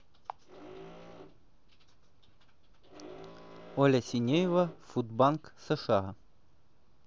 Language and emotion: Russian, neutral